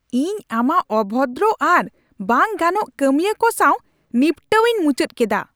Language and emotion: Santali, angry